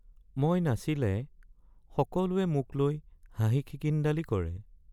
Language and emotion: Assamese, sad